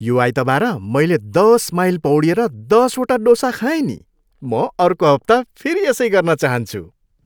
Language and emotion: Nepali, happy